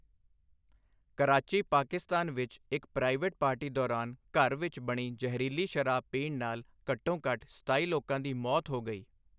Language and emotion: Punjabi, neutral